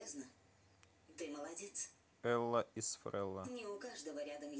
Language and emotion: Russian, neutral